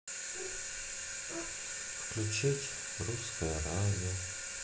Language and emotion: Russian, sad